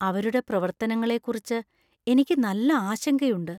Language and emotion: Malayalam, fearful